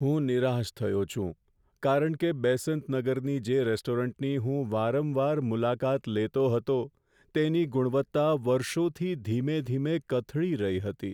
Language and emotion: Gujarati, sad